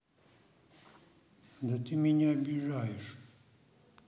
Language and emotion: Russian, sad